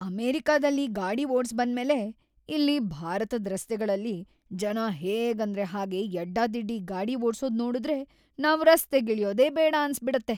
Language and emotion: Kannada, disgusted